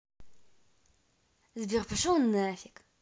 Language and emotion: Russian, angry